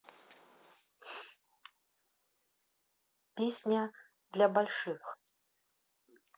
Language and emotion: Russian, neutral